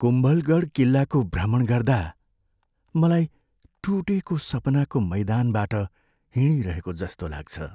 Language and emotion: Nepali, sad